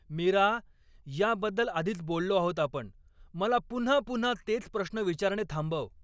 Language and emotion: Marathi, angry